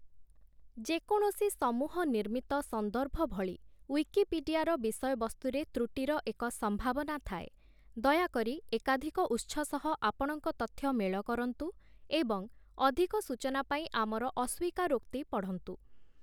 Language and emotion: Odia, neutral